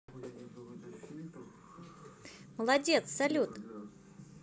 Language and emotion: Russian, positive